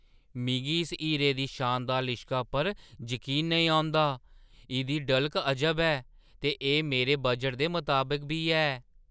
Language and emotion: Dogri, surprised